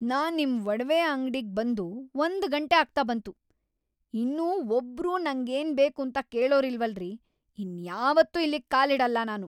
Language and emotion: Kannada, angry